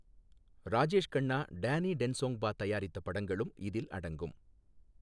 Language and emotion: Tamil, neutral